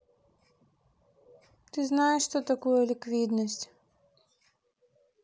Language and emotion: Russian, sad